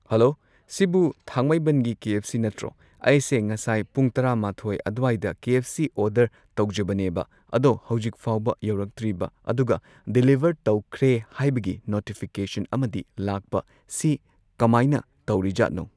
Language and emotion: Manipuri, neutral